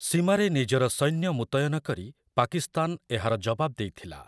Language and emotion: Odia, neutral